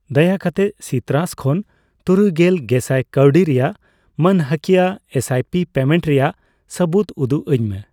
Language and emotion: Santali, neutral